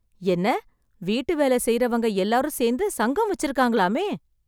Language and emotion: Tamil, surprised